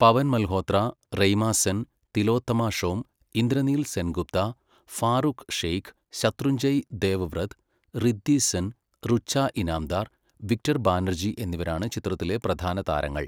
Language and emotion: Malayalam, neutral